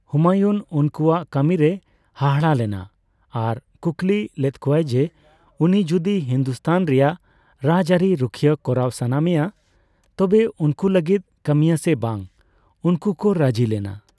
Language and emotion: Santali, neutral